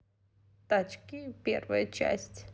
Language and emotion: Russian, positive